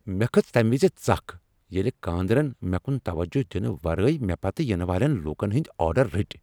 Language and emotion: Kashmiri, angry